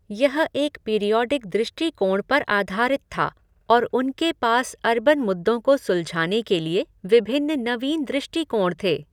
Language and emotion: Hindi, neutral